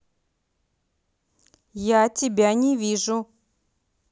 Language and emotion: Russian, angry